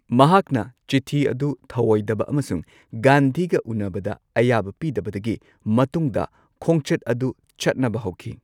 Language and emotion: Manipuri, neutral